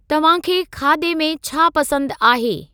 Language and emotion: Sindhi, neutral